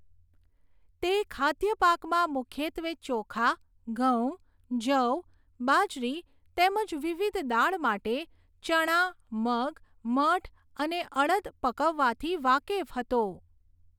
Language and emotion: Gujarati, neutral